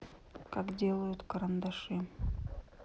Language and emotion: Russian, neutral